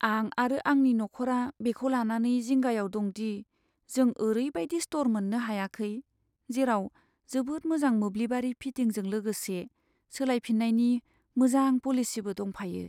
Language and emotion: Bodo, sad